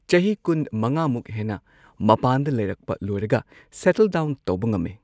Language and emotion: Manipuri, neutral